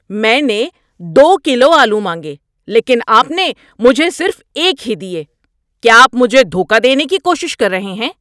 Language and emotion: Urdu, angry